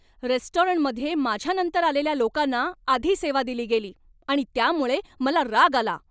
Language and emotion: Marathi, angry